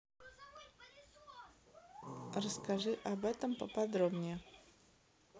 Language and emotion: Russian, neutral